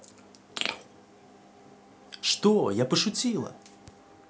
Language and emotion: Russian, positive